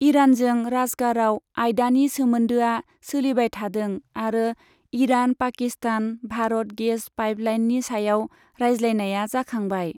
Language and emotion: Bodo, neutral